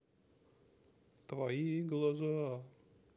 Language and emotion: Russian, sad